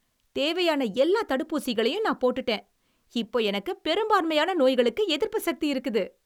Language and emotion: Tamil, happy